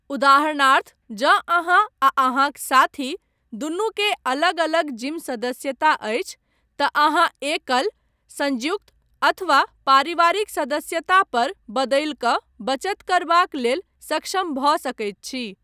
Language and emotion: Maithili, neutral